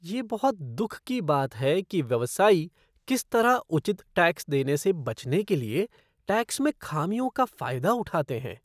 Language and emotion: Hindi, disgusted